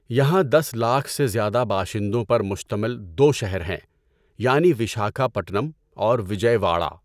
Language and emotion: Urdu, neutral